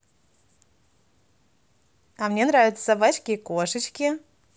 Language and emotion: Russian, positive